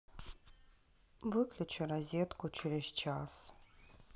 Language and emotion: Russian, sad